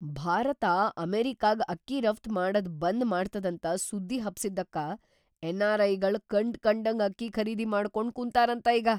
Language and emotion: Kannada, surprised